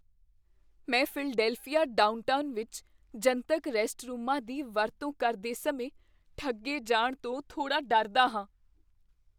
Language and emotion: Punjabi, fearful